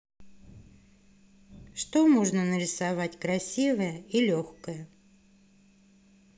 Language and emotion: Russian, neutral